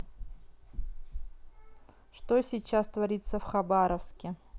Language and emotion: Russian, neutral